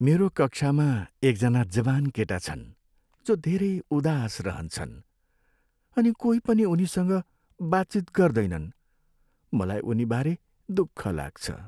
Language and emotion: Nepali, sad